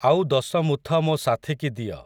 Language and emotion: Odia, neutral